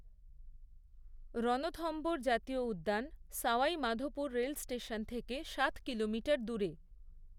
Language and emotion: Bengali, neutral